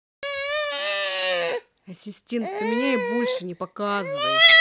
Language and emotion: Russian, angry